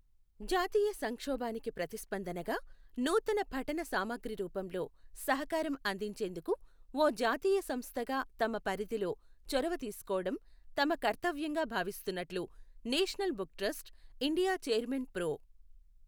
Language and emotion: Telugu, neutral